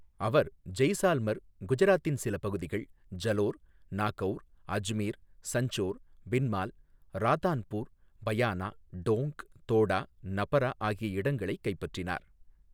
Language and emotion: Tamil, neutral